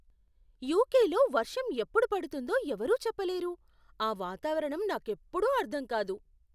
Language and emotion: Telugu, surprised